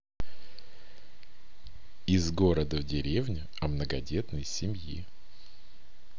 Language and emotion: Russian, neutral